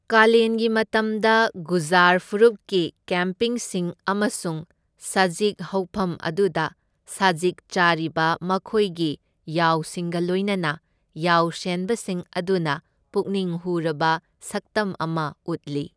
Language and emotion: Manipuri, neutral